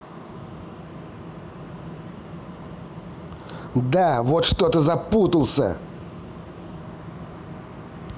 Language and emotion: Russian, angry